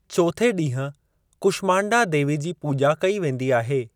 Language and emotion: Sindhi, neutral